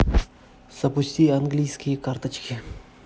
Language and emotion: Russian, neutral